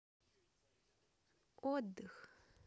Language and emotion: Russian, neutral